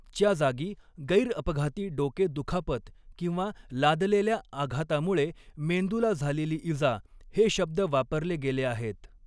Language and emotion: Marathi, neutral